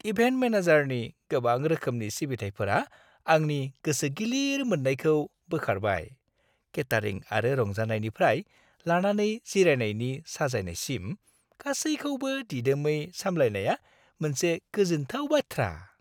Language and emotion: Bodo, happy